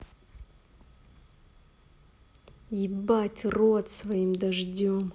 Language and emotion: Russian, angry